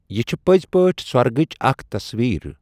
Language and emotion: Kashmiri, neutral